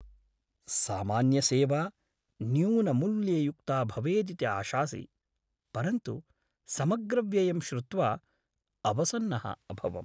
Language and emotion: Sanskrit, sad